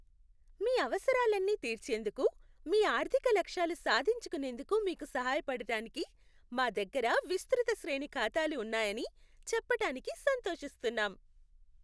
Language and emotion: Telugu, happy